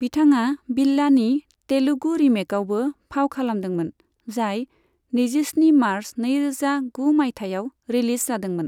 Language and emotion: Bodo, neutral